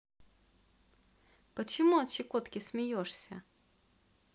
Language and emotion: Russian, positive